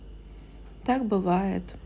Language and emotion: Russian, neutral